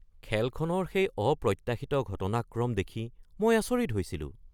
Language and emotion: Assamese, surprised